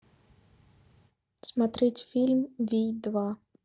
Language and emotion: Russian, neutral